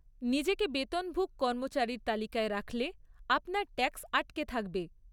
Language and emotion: Bengali, neutral